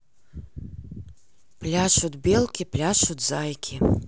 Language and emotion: Russian, neutral